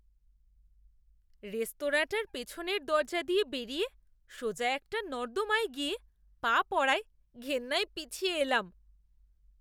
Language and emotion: Bengali, disgusted